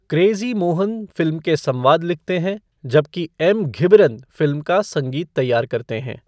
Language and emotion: Hindi, neutral